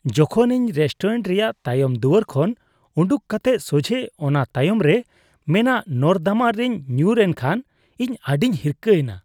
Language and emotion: Santali, disgusted